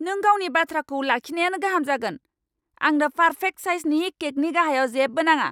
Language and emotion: Bodo, angry